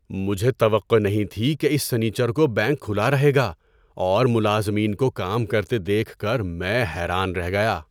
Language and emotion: Urdu, surprised